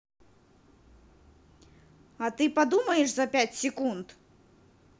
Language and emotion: Russian, angry